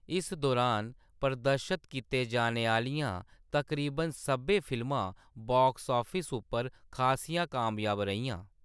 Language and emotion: Dogri, neutral